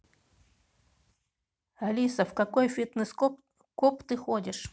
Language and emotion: Russian, neutral